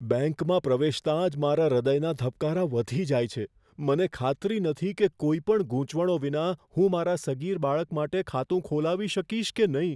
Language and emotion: Gujarati, fearful